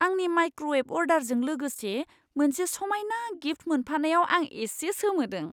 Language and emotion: Bodo, surprised